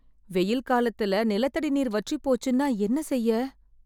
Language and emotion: Tamil, fearful